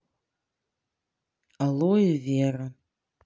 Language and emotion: Russian, neutral